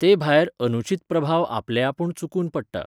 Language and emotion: Goan Konkani, neutral